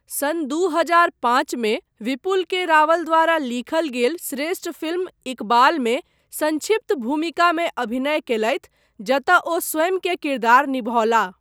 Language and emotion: Maithili, neutral